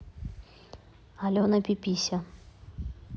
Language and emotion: Russian, neutral